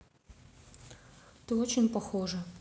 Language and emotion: Russian, neutral